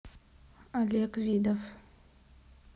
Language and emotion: Russian, neutral